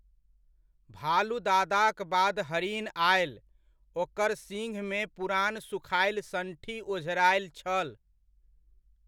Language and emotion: Maithili, neutral